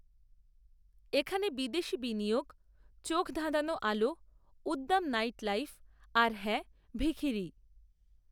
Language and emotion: Bengali, neutral